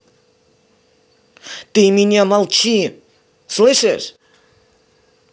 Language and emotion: Russian, angry